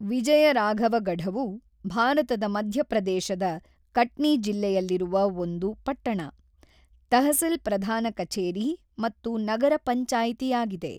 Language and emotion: Kannada, neutral